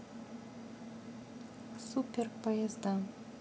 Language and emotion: Russian, neutral